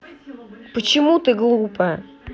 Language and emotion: Russian, angry